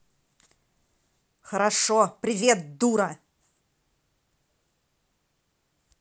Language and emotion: Russian, angry